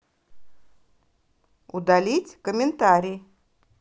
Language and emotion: Russian, positive